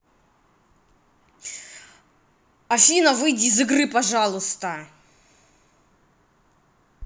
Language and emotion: Russian, angry